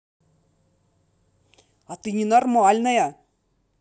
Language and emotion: Russian, angry